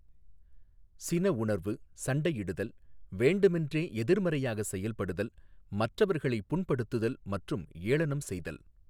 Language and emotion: Tamil, neutral